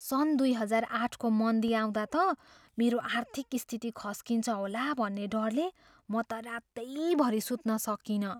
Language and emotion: Nepali, fearful